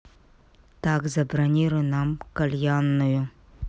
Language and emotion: Russian, neutral